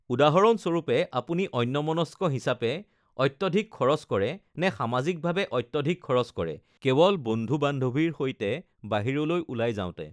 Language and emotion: Assamese, neutral